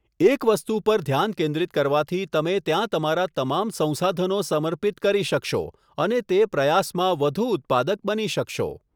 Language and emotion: Gujarati, neutral